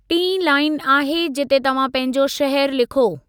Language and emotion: Sindhi, neutral